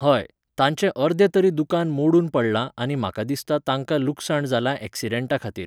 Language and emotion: Goan Konkani, neutral